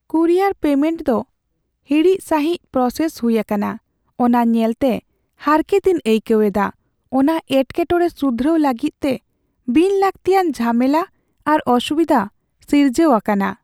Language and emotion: Santali, sad